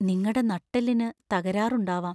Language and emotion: Malayalam, fearful